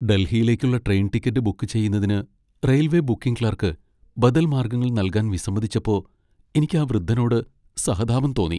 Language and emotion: Malayalam, sad